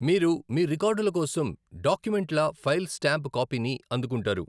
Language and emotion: Telugu, neutral